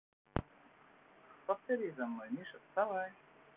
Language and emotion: Russian, positive